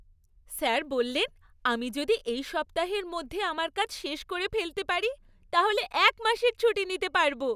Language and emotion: Bengali, happy